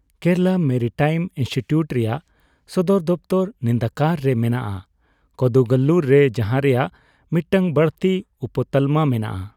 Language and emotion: Santali, neutral